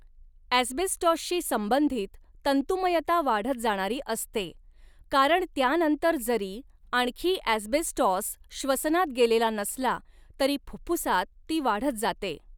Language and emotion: Marathi, neutral